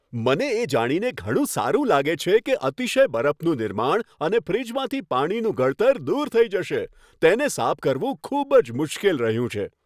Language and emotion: Gujarati, happy